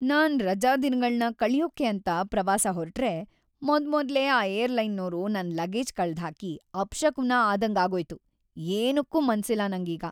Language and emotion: Kannada, sad